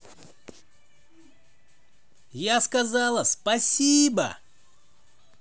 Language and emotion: Russian, positive